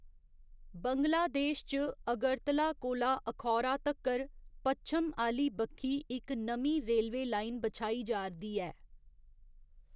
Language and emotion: Dogri, neutral